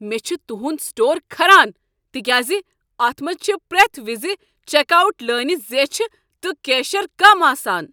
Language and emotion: Kashmiri, angry